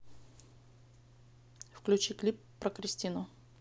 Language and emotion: Russian, neutral